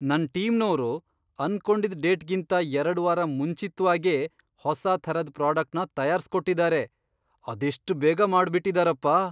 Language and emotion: Kannada, surprised